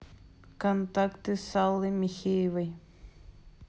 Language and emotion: Russian, neutral